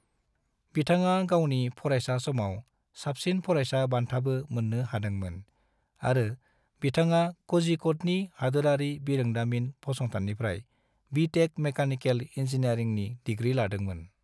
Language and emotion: Bodo, neutral